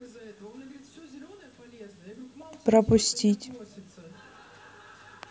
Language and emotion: Russian, neutral